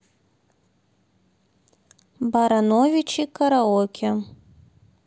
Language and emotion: Russian, neutral